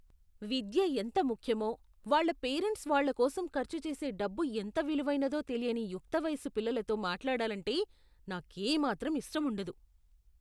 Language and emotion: Telugu, disgusted